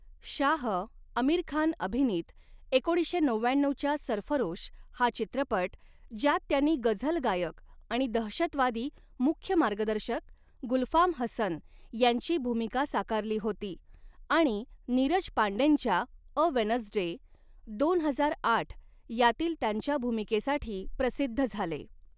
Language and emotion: Marathi, neutral